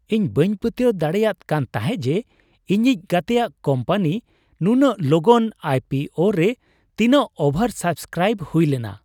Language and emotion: Santali, surprised